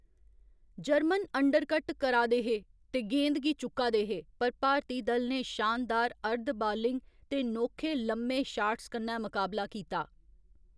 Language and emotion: Dogri, neutral